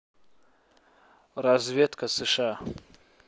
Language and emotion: Russian, neutral